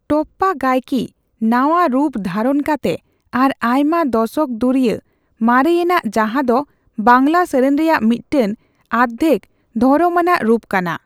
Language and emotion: Santali, neutral